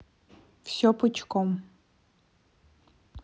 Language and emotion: Russian, neutral